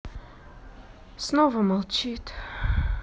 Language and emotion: Russian, sad